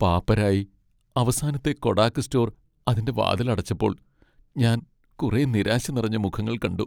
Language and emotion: Malayalam, sad